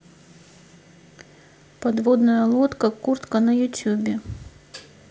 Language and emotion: Russian, neutral